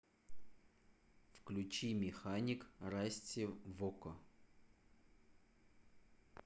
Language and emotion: Russian, neutral